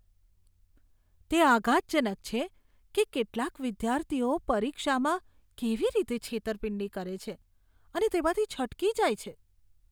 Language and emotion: Gujarati, disgusted